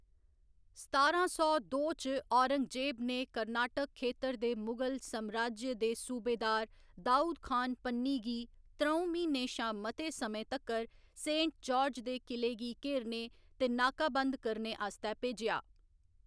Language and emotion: Dogri, neutral